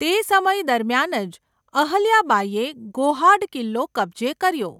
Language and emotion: Gujarati, neutral